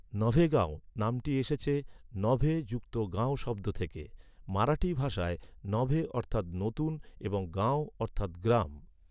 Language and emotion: Bengali, neutral